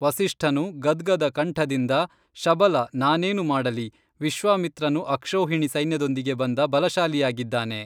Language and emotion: Kannada, neutral